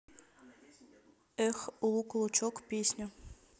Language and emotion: Russian, neutral